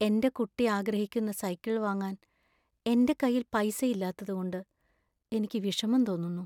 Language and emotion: Malayalam, sad